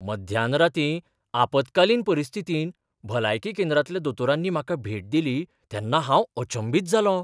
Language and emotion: Goan Konkani, surprised